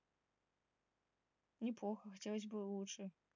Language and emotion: Russian, neutral